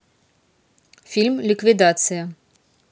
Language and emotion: Russian, neutral